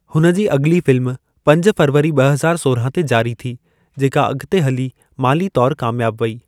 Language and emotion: Sindhi, neutral